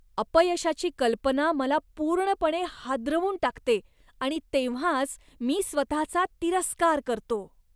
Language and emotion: Marathi, disgusted